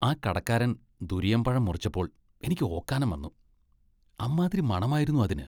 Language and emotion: Malayalam, disgusted